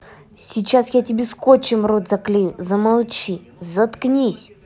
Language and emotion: Russian, angry